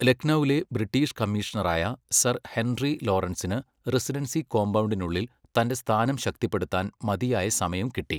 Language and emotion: Malayalam, neutral